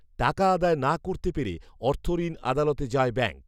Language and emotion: Bengali, neutral